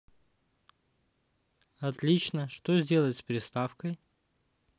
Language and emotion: Russian, neutral